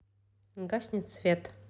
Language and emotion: Russian, neutral